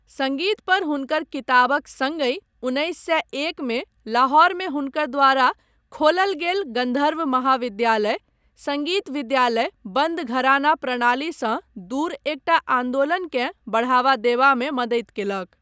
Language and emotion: Maithili, neutral